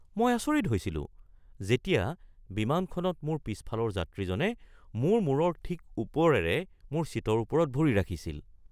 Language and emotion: Assamese, surprised